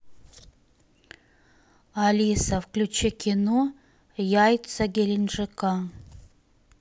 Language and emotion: Russian, neutral